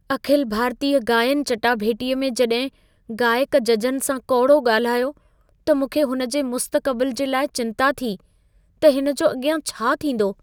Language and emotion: Sindhi, fearful